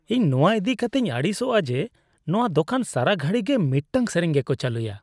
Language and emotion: Santali, disgusted